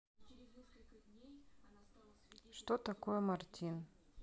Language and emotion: Russian, neutral